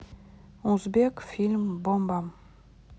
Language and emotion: Russian, neutral